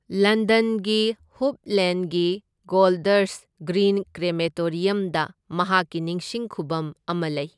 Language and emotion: Manipuri, neutral